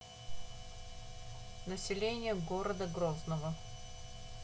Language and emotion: Russian, neutral